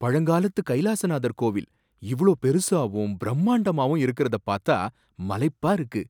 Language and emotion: Tamil, surprised